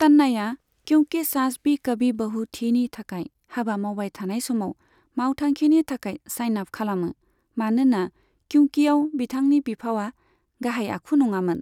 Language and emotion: Bodo, neutral